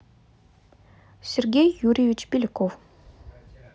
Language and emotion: Russian, neutral